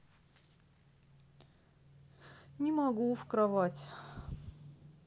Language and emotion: Russian, sad